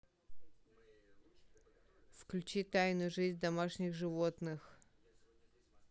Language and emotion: Russian, neutral